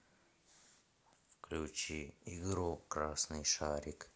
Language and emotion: Russian, neutral